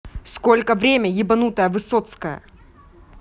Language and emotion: Russian, angry